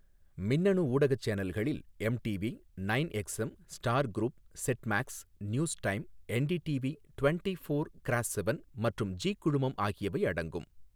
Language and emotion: Tamil, neutral